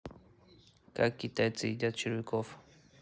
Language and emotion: Russian, neutral